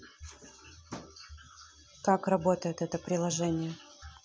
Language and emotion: Russian, neutral